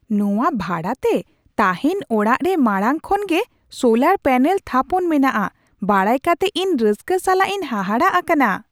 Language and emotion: Santali, surprised